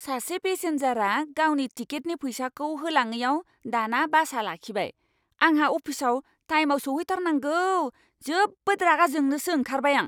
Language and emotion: Bodo, angry